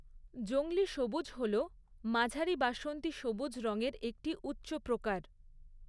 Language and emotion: Bengali, neutral